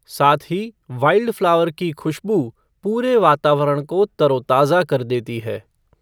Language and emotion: Hindi, neutral